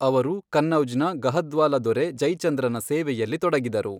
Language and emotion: Kannada, neutral